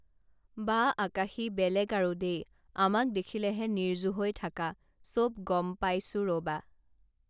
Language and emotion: Assamese, neutral